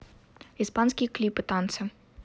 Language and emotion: Russian, neutral